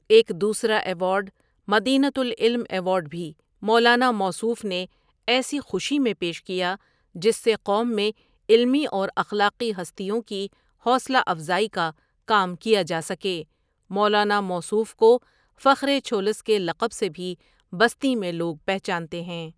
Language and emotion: Urdu, neutral